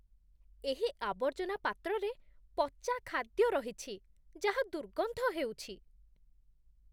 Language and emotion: Odia, disgusted